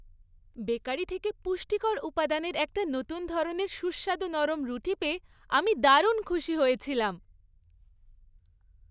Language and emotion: Bengali, happy